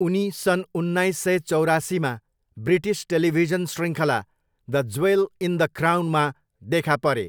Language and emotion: Nepali, neutral